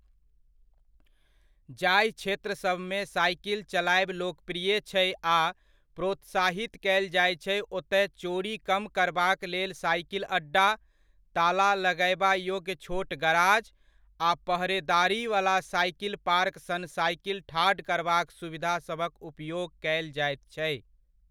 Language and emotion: Maithili, neutral